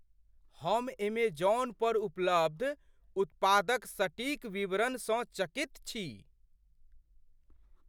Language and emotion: Maithili, surprised